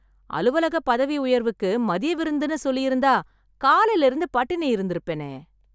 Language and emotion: Tamil, happy